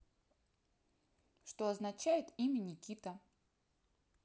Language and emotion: Russian, neutral